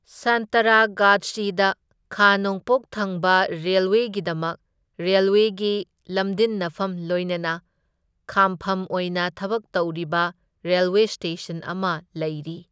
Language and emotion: Manipuri, neutral